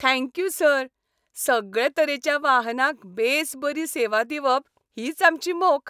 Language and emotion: Goan Konkani, happy